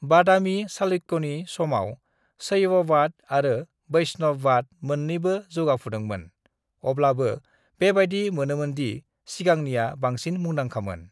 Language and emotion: Bodo, neutral